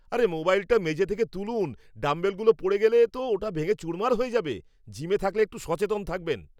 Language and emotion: Bengali, angry